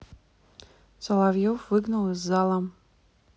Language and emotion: Russian, neutral